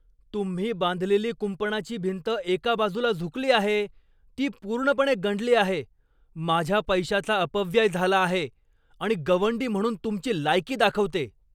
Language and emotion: Marathi, angry